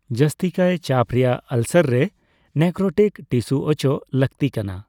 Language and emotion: Santali, neutral